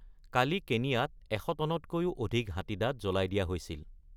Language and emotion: Assamese, neutral